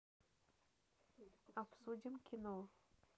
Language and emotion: Russian, neutral